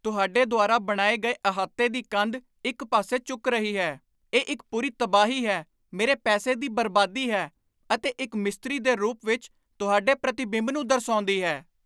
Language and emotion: Punjabi, angry